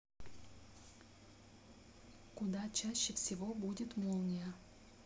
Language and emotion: Russian, neutral